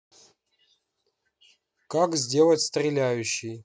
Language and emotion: Russian, neutral